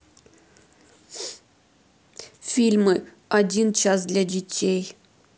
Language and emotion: Russian, sad